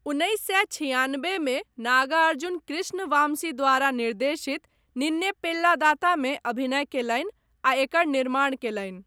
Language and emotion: Maithili, neutral